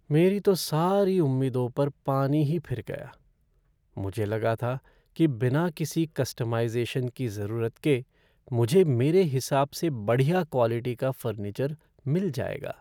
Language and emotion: Hindi, sad